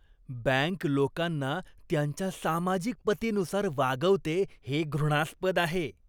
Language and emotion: Marathi, disgusted